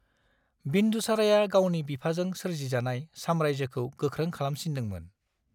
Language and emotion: Bodo, neutral